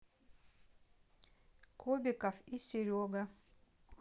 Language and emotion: Russian, neutral